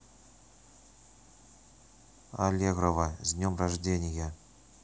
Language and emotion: Russian, neutral